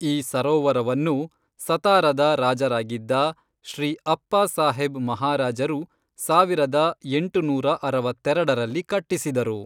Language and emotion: Kannada, neutral